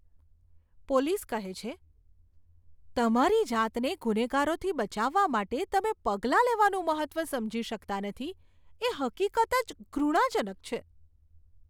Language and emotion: Gujarati, disgusted